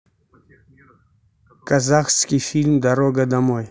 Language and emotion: Russian, neutral